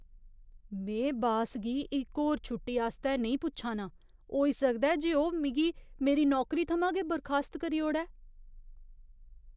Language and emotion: Dogri, fearful